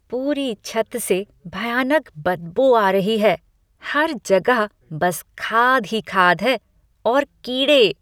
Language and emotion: Hindi, disgusted